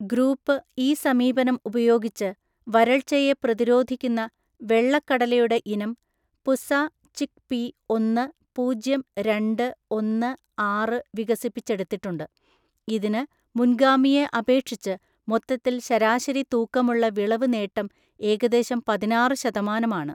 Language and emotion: Malayalam, neutral